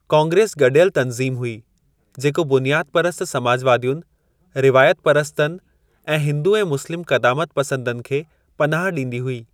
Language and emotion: Sindhi, neutral